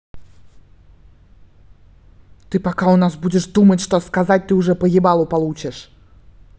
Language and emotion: Russian, angry